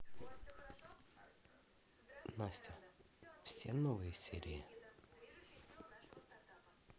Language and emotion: Russian, neutral